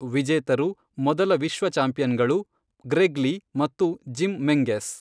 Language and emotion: Kannada, neutral